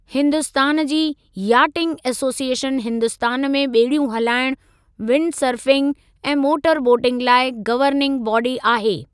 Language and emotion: Sindhi, neutral